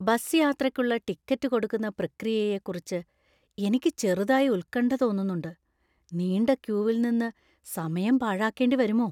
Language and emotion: Malayalam, fearful